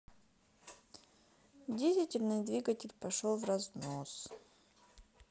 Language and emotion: Russian, sad